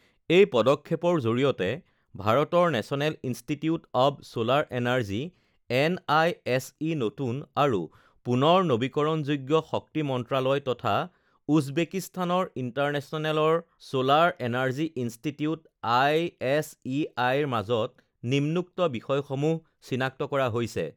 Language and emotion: Assamese, neutral